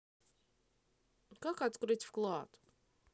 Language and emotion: Russian, neutral